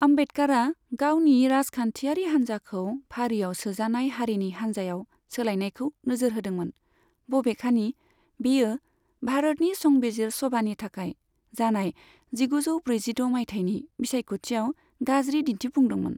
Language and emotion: Bodo, neutral